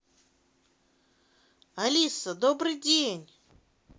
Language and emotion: Russian, positive